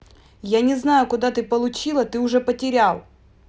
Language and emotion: Russian, angry